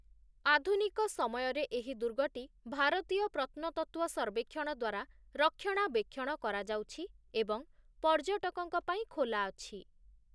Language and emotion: Odia, neutral